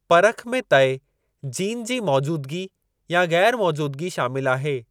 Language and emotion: Sindhi, neutral